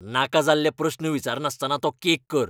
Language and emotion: Goan Konkani, angry